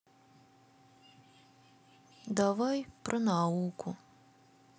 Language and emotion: Russian, sad